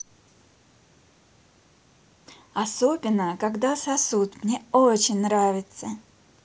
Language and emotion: Russian, positive